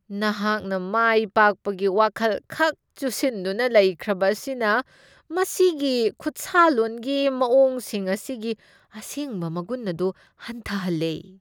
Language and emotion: Manipuri, disgusted